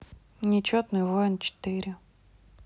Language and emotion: Russian, neutral